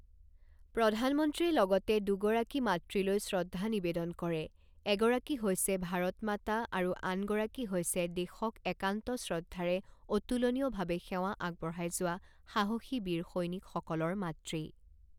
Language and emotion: Assamese, neutral